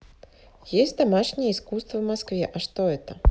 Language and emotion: Russian, neutral